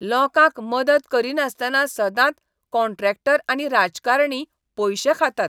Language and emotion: Goan Konkani, disgusted